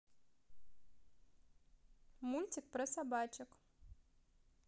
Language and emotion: Russian, positive